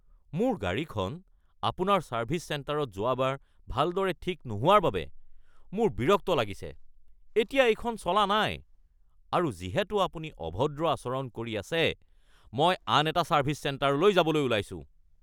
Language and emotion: Assamese, angry